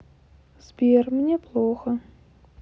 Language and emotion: Russian, sad